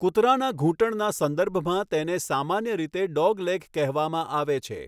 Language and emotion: Gujarati, neutral